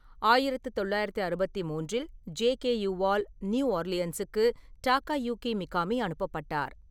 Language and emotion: Tamil, neutral